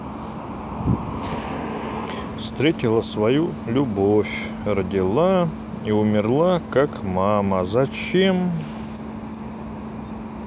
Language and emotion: Russian, neutral